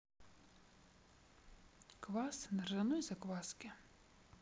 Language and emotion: Russian, neutral